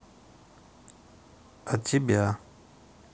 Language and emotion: Russian, neutral